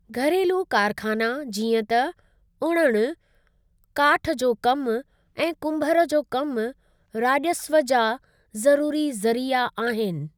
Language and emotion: Sindhi, neutral